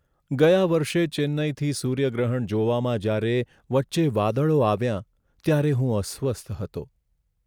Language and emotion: Gujarati, sad